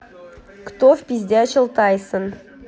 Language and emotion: Russian, neutral